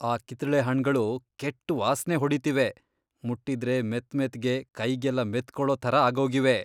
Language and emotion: Kannada, disgusted